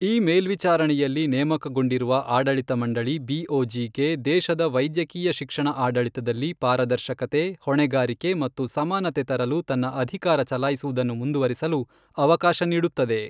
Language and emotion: Kannada, neutral